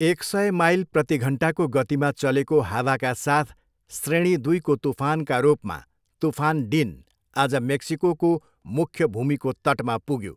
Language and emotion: Nepali, neutral